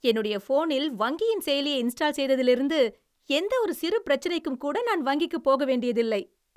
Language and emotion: Tamil, happy